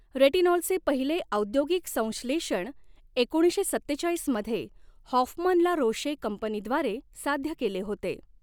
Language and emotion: Marathi, neutral